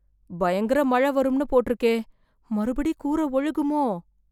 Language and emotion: Tamil, fearful